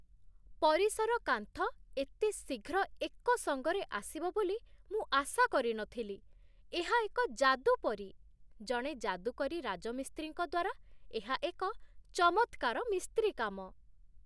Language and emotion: Odia, surprised